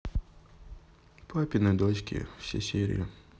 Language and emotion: Russian, sad